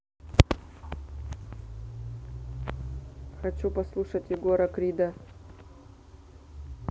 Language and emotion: Russian, neutral